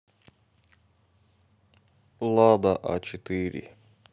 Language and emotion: Russian, neutral